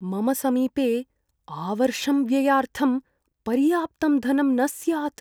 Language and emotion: Sanskrit, fearful